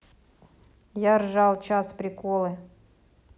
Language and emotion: Russian, neutral